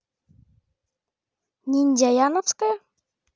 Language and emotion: Russian, neutral